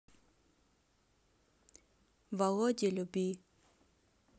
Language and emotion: Russian, neutral